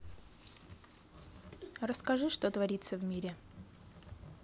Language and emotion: Russian, neutral